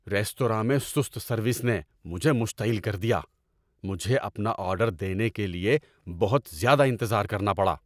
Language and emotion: Urdu, angry